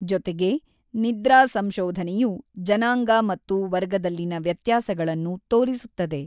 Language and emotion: Kannada, neutral